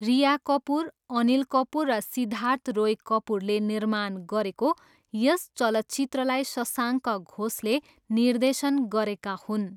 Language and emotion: Nepali, neutral